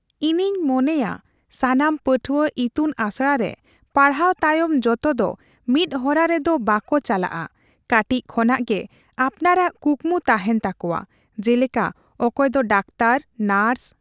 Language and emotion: Santali, neutral